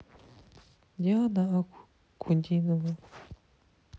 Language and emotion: Russian, sad